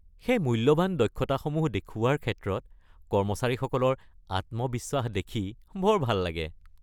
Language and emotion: Assamese, happy